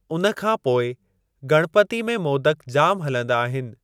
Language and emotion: Sindhi, neutral